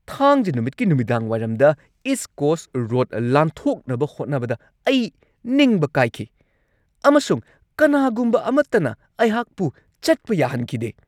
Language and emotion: Manipuri, angry